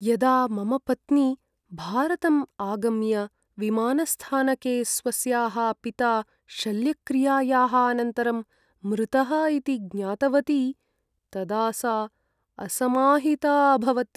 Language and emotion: Sanskrit, sad